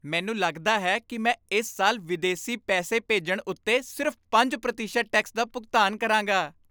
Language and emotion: Punjabi, happy